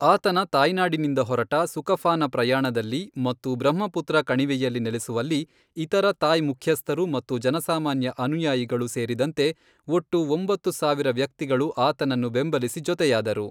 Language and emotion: Kannada, neutral